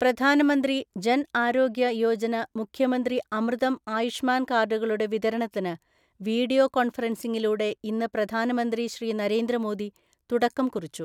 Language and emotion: Malayalam, neutral